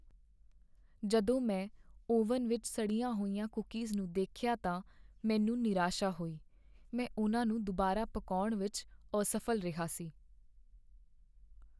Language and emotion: Punjabi, sad